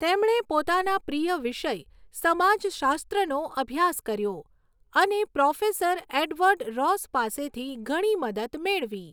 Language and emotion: Gujarati, neutral